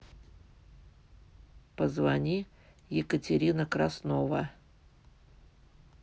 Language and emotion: Russian, neutral